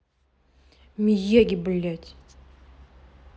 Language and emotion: Russian, angry